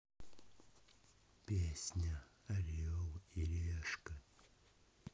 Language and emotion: Russian, neutral